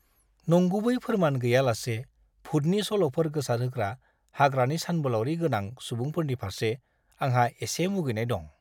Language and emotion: Bodo, disgusted